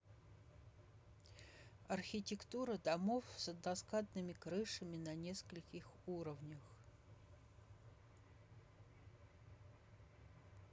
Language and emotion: Russian, neutral